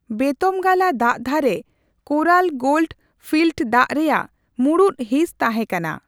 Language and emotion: Santali, neutral